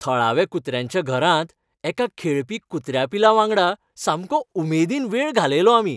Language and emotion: Goan Konkani, happy